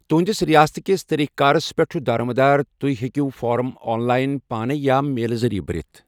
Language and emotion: Kashmiri, neutral